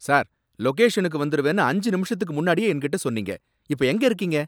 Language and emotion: Tamil, angry